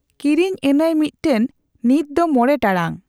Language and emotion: Santali, neutral